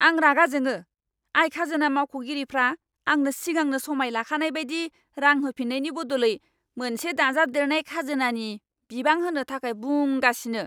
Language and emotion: Bodo, angry